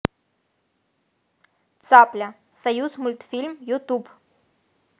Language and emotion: Russian, positive